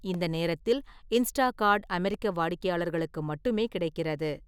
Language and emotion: Tamil, neutral